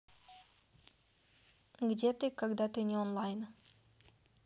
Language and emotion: Russian, neutral